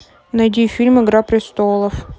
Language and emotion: Russian, neutral